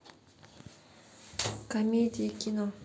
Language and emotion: Russian, neutral